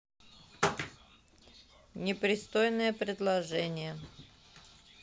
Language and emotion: Russian, neutral